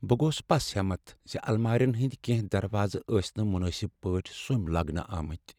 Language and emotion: Kashmiri, sad